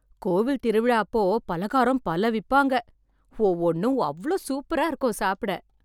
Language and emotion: Tamil, happy